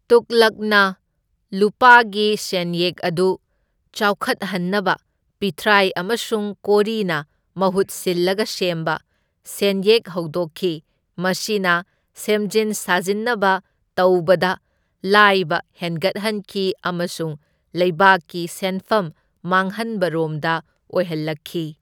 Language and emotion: Manipuri, neutral